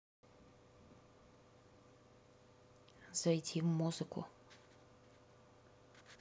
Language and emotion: Russian, neutral